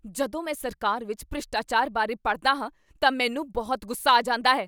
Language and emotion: Punjabi, angry